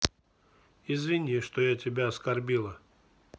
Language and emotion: Russian, neutral